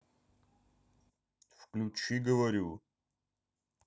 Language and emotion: Russian, angry